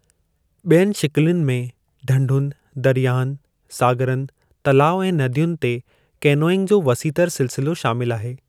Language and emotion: Sindhi, neutral